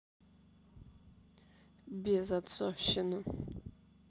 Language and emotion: Russian, sad